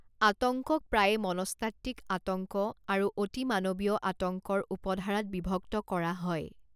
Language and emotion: Assamese, neutral